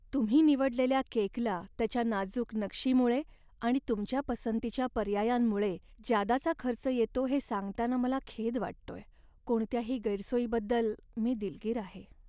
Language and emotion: Marathi, sad